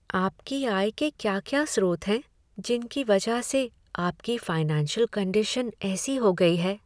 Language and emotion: Hindi, sad